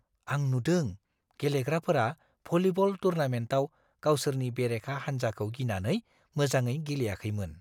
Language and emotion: Bodo, fearful